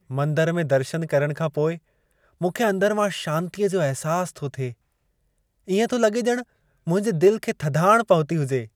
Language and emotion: Sindhi, happy